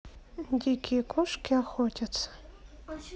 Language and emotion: Russian, neutral